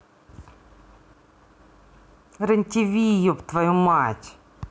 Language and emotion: Russian, angry